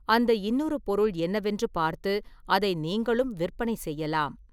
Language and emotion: Tamil, neutral